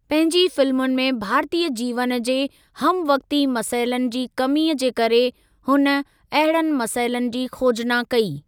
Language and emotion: Sindhi, neutral